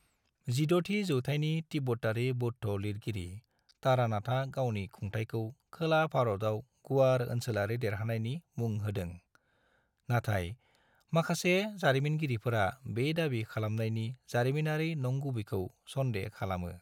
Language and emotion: Bodo, neutral